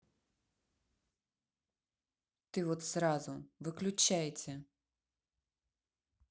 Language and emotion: Russian, neutral